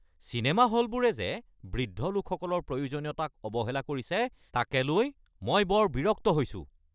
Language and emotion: Assamese, angry